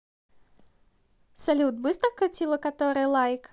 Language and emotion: Russian, positive